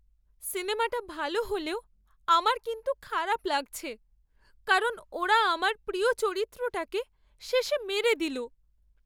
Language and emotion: Bengali, sad